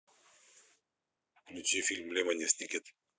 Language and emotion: Russian, neutral